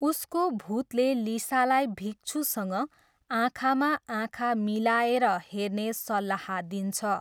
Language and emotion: Nepali, neutral